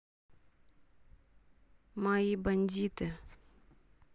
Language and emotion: Russian, neutral